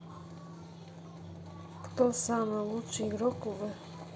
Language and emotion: Russian, neutral